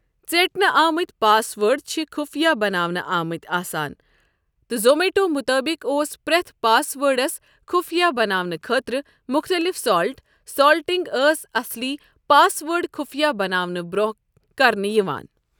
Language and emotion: Kashmiri, neutral